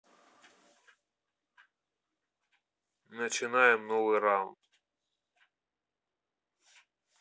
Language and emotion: Russian, neutral